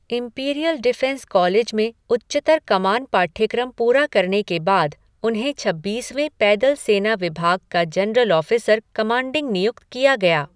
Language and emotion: Hindi, neutral